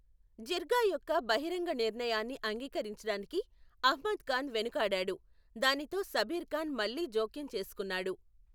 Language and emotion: Telugu, neutral